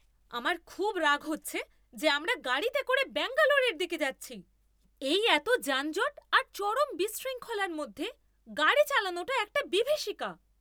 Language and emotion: Bengali, angry